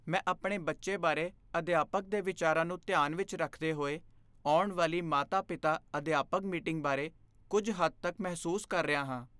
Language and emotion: Punjabi, fearful